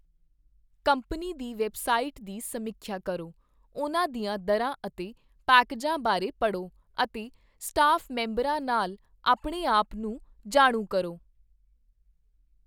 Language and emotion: Punjabi, neutral